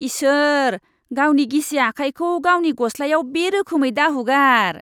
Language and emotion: Bodo, disgusted